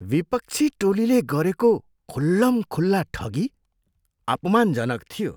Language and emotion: Nepali, disgusted